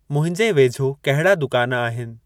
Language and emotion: Sindhi, neutral